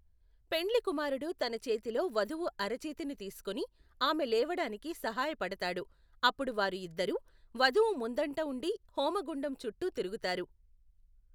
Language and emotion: Telugu, neutral